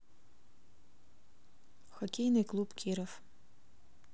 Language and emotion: Russian, neutral